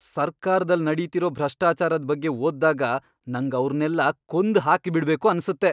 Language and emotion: Kannada, angry